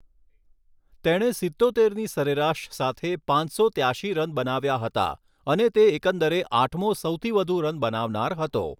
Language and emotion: Gujarati, neutral